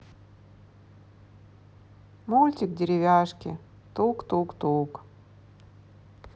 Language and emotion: Russian, sad